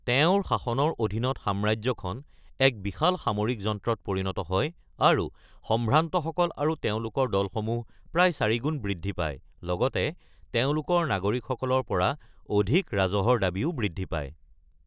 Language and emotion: Assamese, neutral